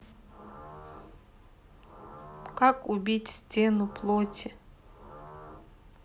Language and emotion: Russian, neutral